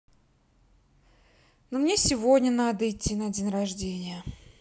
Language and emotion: Russian, sad